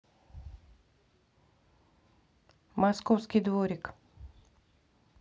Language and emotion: Russian, neutral